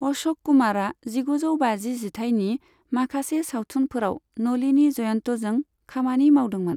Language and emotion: Bodo, neutral